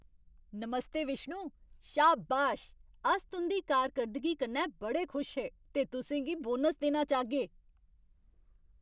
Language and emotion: Dogri, happy